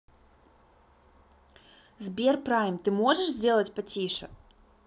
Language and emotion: Russian, neutral